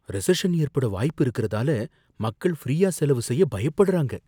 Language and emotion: Tamil, fearful